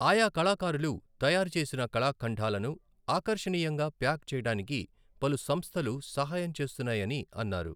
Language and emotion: Telugu, neutral